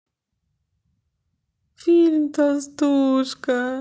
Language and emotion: Russian, sad